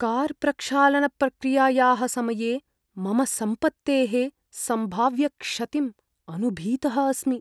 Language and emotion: Sanskrit, fearful